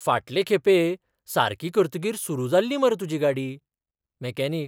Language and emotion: Goan Konkani, surprised